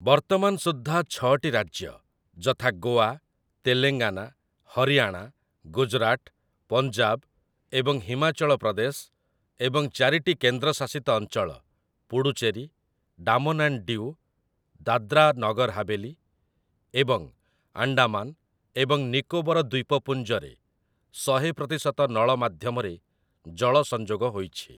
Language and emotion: Odia, neutral